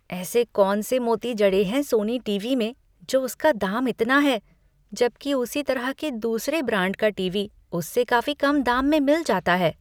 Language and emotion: Hindi, disgusted